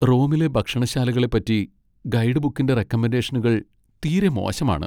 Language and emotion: Malayalam, sad